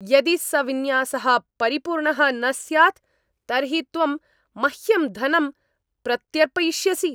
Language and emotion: Sanskrit, angry